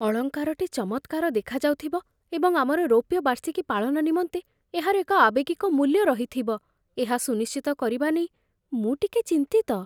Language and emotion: Odia, fearful